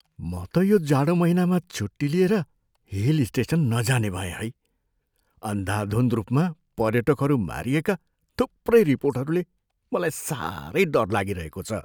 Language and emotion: Nepali, fearful